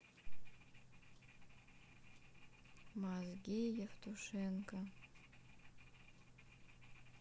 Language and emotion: Russian, sad